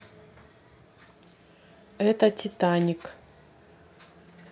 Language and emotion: Russian, neutral